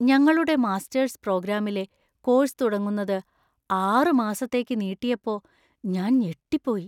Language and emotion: Malayalam, fearful